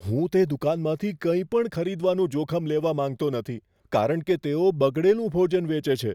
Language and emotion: Gujarati, fearful